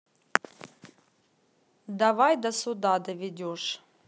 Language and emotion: Russian, neutral